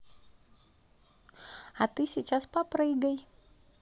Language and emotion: Russian, positive